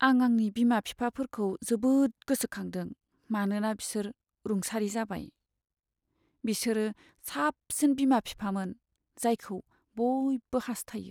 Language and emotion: Bodo, sad